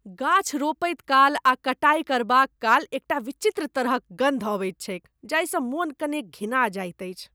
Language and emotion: Maithili, disgusted